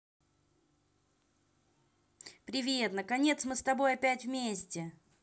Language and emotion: Russian, positive